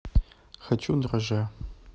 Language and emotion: Russian, neutral